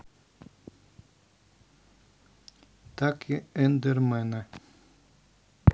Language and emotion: Russian, neutral